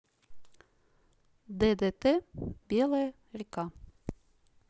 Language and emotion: Russian, neutral